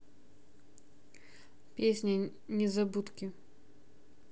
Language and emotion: Russian, neutral